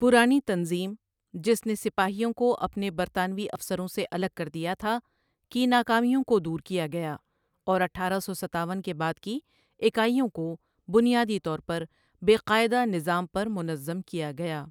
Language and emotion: Urdu, neutral